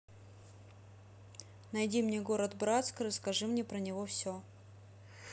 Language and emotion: Russian, neutral